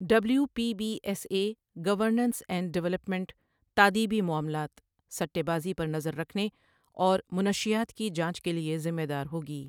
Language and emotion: Urdu, neutral